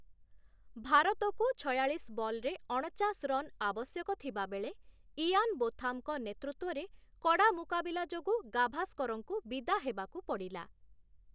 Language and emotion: Odia, neutral